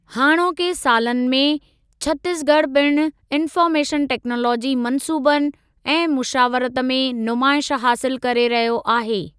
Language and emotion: Sindhi, neutral